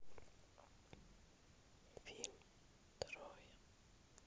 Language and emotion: Russian, neutral